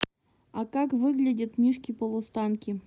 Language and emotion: Russian, neutral